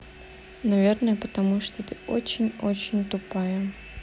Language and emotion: Russian, neutral